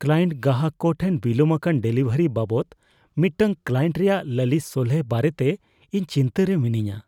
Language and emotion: Santali, fearful